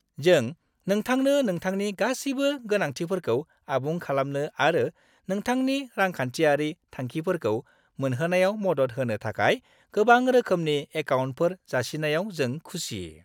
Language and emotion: Bodo, happy